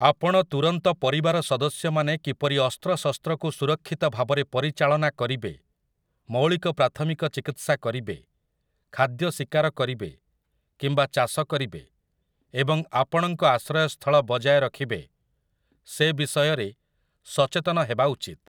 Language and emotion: Odia, neutral